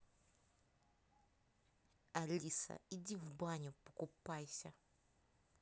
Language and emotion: Russian, angry